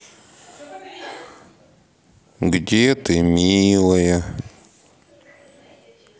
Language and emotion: Russian, sad